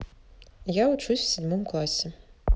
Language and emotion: Russian, neutral